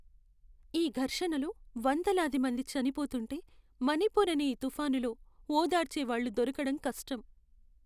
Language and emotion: Telugu, sad